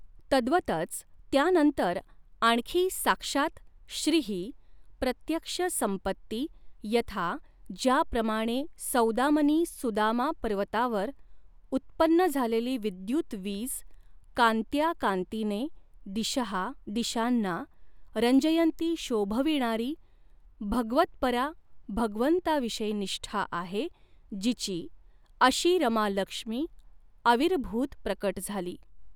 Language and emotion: Marathi, neutral